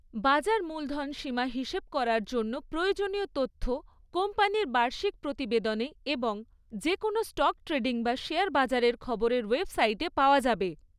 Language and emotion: Bengali, neutral